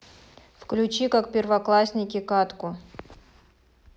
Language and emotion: Russian, neutral